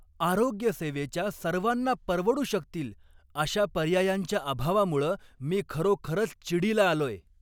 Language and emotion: Marathi, angry